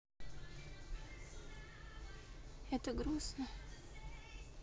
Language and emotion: Russian, sad